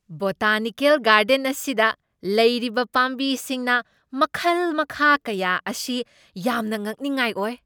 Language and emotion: Manipuri, surprised